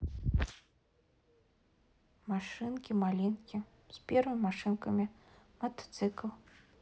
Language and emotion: Russian, neutral